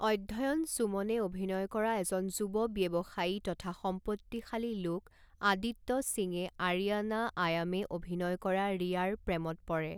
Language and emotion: Assamese, neutral